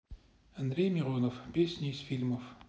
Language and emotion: Russian, neutral